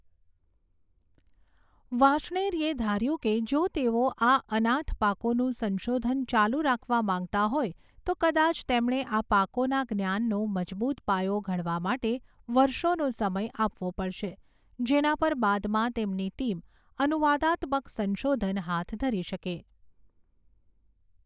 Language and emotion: Gujarati, neutral